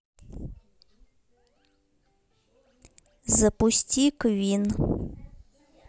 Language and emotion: Russian, neutral